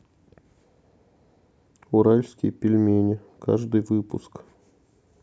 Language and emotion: Russian, neutral